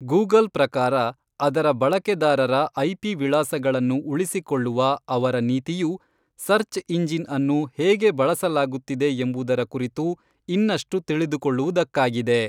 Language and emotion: Kannada, neutral